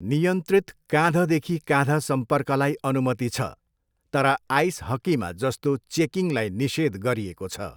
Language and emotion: Nepali, neutral